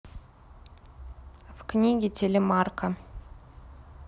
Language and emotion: Russian, neutral